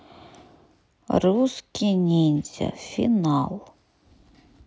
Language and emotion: Russian, neutral